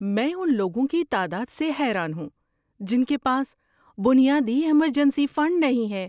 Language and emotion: Urdu, surprised